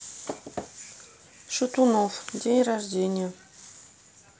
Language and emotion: Russian, neutral